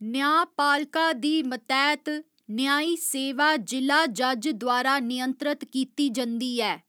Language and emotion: Dogri, neutral